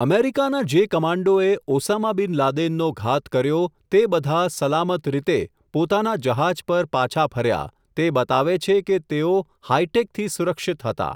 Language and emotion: Gujarati, neutral